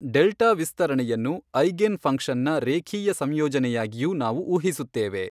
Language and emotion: Kannada, neutral